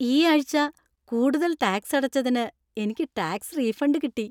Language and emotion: Malayalam, happy